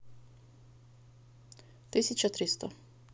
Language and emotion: Russian, neutral